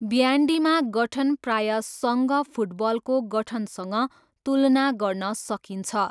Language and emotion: Nepali, neutral